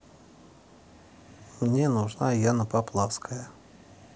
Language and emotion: Russian, neutral